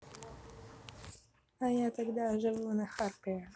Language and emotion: Russian, neutral